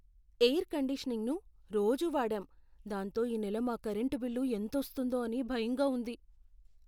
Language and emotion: Telugu, fearful